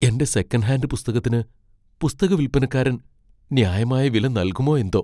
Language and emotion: Malayalam, fearful